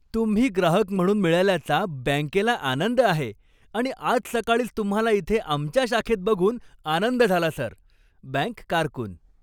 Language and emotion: Marathi, happy